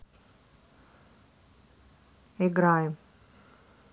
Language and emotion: Russian, neutral